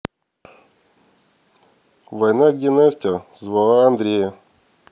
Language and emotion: Russian, neutral